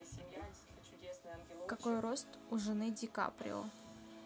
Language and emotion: Russian, neutral